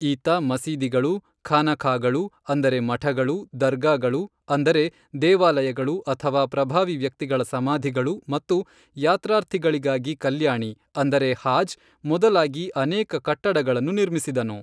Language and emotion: Kannada, neutral